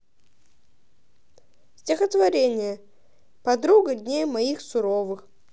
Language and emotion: Russian, neutral